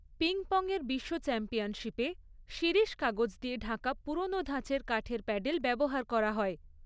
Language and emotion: Bengali, neutral